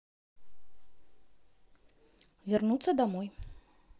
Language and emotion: Russian, neutral